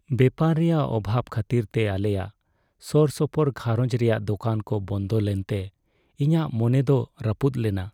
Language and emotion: Santali, sad